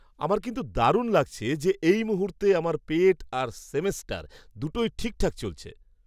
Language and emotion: Bengali, happy